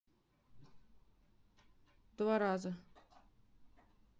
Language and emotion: Russian, neutral